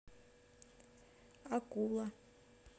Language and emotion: Russian, neutral